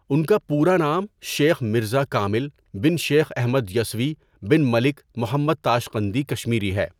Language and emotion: Urdu, neutral